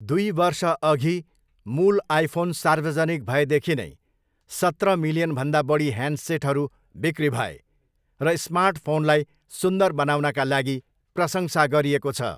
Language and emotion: Nepali, neutral